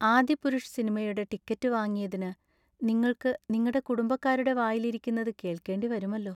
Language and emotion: Malayalam, sad